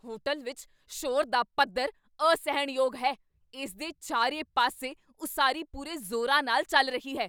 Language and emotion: Punjabi, angry